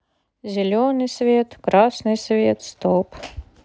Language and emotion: Russian, neutral